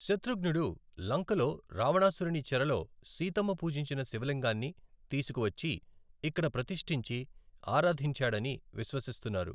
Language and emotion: Telugu, neutral